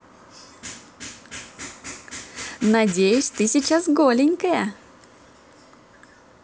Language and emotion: Russian, positive